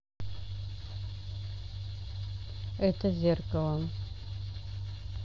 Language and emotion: Russian, neutral